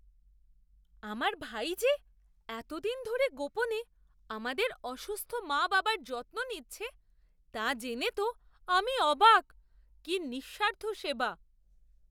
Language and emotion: Bengali, surprised